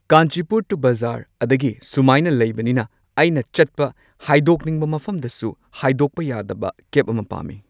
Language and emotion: Manipuri, neutral